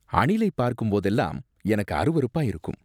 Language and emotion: Tamil, disgusted